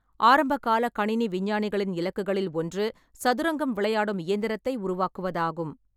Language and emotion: Tamil, neutral